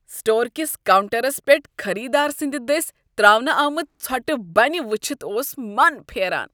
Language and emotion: Kashmiri, disgusted